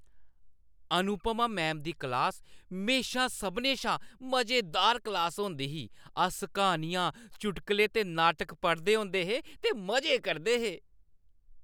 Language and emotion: Dogri, happy